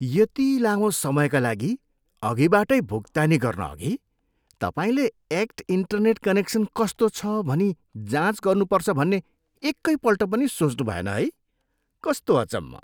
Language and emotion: Nepali, disgusted